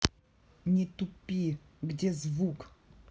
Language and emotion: Russian, angry